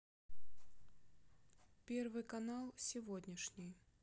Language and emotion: Russian, neutral